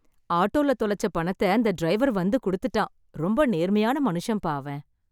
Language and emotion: Tamil, happy